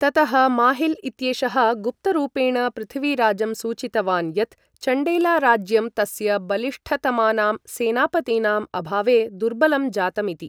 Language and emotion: Sanskrit, neutral